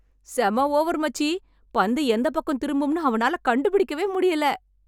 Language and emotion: Tamil, happy